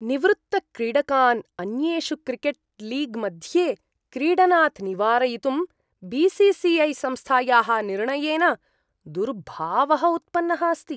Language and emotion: Sanskrit, disgusted